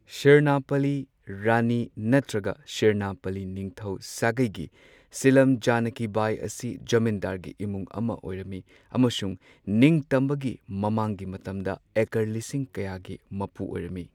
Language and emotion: Manipuri, neutral